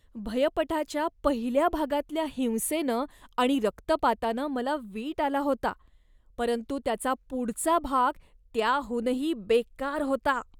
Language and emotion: Marathi, disgusted